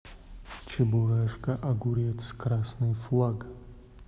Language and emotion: Russian, neutral